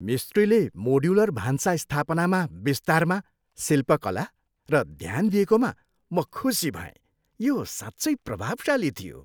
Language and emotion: Nepali, happy